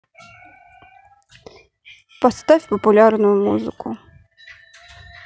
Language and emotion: Russian, neutral